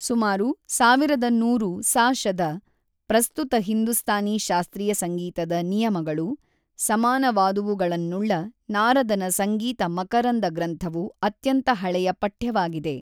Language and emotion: Kannada, neutral